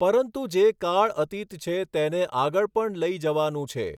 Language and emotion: Gujarati, neutral